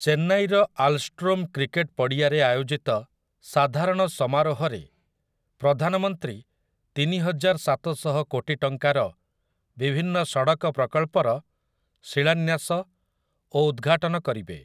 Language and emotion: Odia, neutral